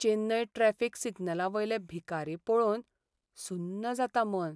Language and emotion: Goan Konkani, sad